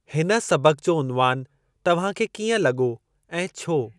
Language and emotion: Sindhi, neutral